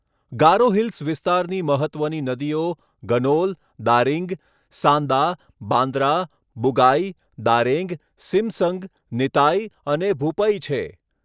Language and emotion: Gujarati, neutral